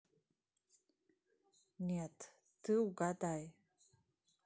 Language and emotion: Russian, neutral